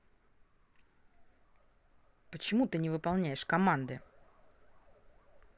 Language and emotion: Russian, angry